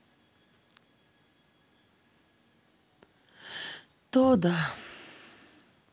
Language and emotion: Russian, sad